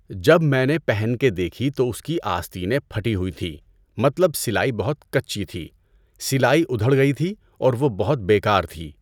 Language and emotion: Urdu, neutral